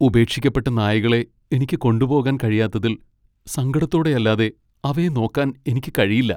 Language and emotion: Malayalam, sad